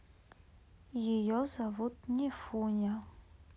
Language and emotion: Russian, neutral